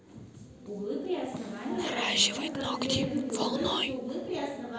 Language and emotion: Russian, neutral